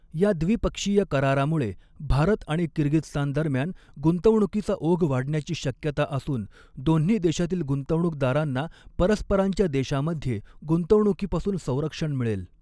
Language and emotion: Marathi, neutral